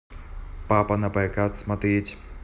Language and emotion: Russian, neutral